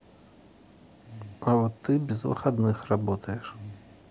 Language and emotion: Russian, neutral